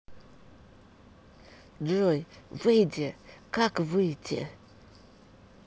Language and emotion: Russian, neutral